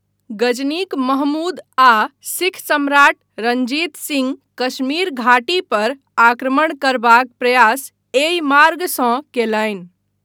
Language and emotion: Maithili, neutral